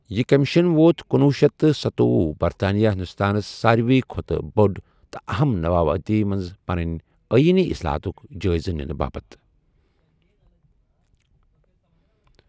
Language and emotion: Kashmiri, neutral